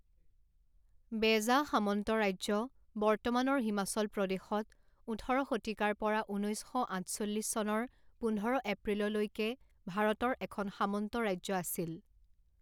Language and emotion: Assamese, neutral